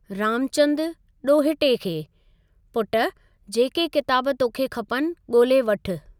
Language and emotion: Sindhi, neutral